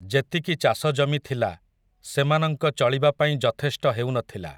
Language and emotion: Odia, neutral